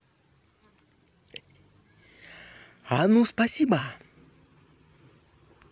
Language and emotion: Russian, positive